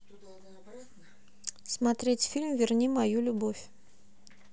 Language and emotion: Russian, neutral